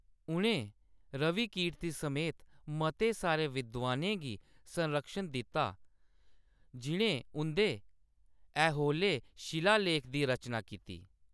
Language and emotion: Dogri, neutral